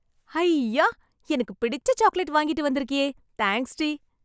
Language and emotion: Tamil, happy